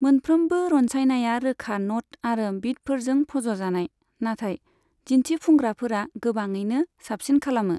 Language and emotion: Bodo, neutral